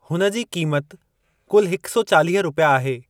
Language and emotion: Sindhi, neutral